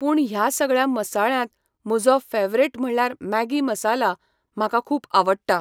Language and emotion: Goan Konkani, neutral